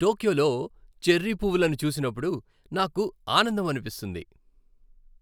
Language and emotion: Telugu, happy